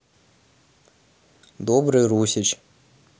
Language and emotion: Russian, neutral